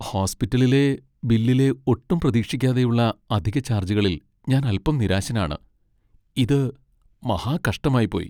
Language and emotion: Malayalam, sad